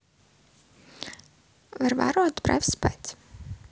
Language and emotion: Russian, neutral